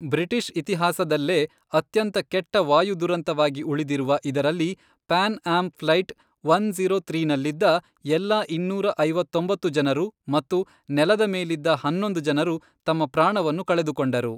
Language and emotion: Kannada, neutral